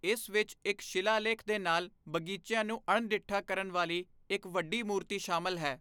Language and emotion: Punjabi, neutral